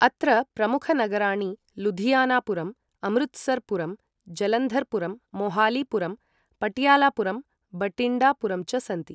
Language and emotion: Sanskrit, neutral